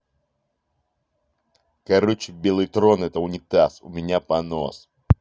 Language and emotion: Russian, angry